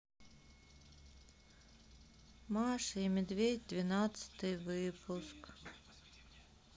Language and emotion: Russian, sad